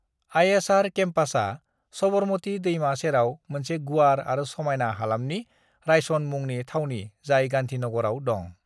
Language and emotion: Bodo, neutral